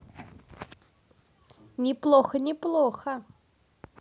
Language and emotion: Russian, neutral